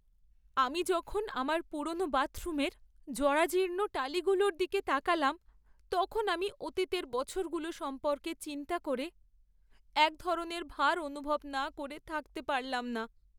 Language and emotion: Bengali, sad